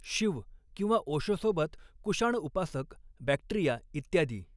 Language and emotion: Marathi, neutral